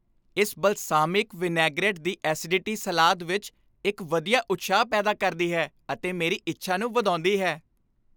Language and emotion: Punjabi, happy